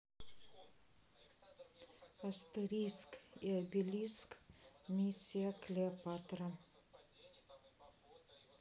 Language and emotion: Russian, neutral